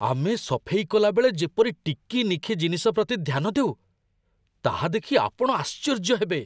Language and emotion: Odia, surprised